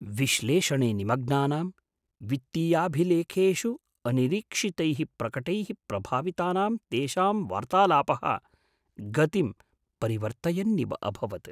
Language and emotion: Sanskrit, surprised